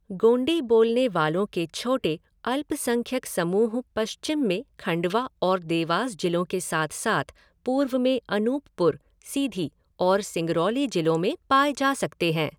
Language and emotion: Hindi, neutral